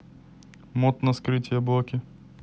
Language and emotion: Russian, neutral